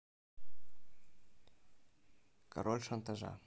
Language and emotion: Russian, neutral